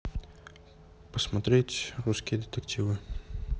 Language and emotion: Russian, neutral